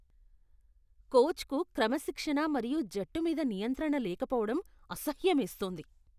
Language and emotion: Telugu, disgusted